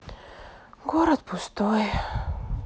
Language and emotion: Russian, sad